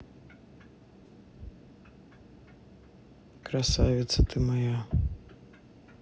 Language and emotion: Russian, sad